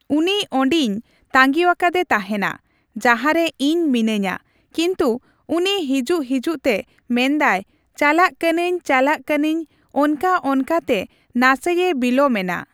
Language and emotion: Santali, neutral